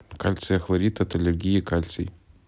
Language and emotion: Russian, neutral